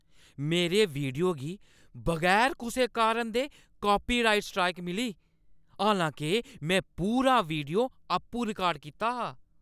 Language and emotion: Dogri, angry